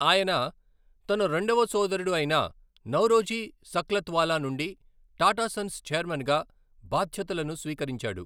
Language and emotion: Telugu, neutral